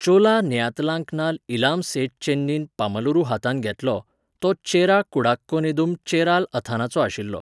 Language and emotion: Goan Konkani, neutral